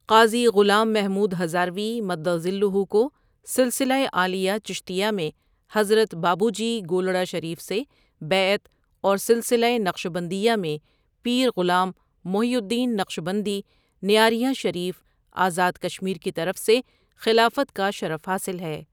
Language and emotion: Urdu, neutral